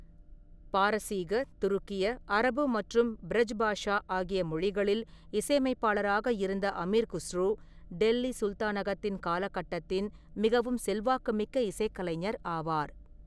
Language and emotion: Tamil, neutral